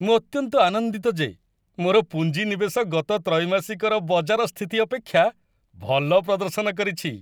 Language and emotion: Odia, happy